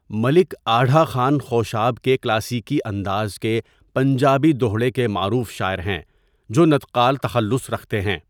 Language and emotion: Urdu, neutral